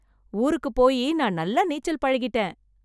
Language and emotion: Tamil, happy